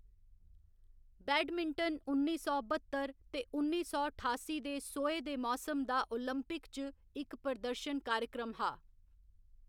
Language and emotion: Dogri, neutral